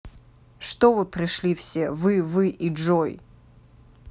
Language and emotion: Russian, angry